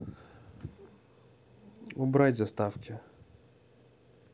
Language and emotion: Russian, neutral